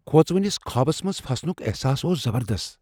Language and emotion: Kashmiri, fearful